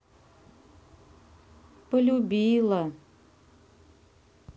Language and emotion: Russian, sad